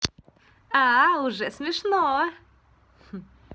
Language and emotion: Russian, positive